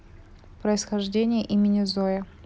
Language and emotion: Russian, neutral